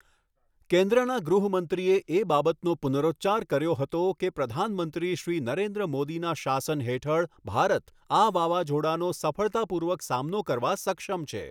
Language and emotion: Gujarati, neutral